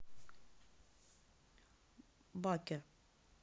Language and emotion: Russian, neutral